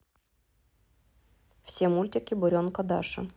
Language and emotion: Russian, neutral